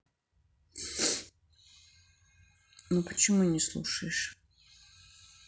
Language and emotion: Russian, sad